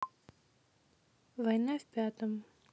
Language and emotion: Russian, neutral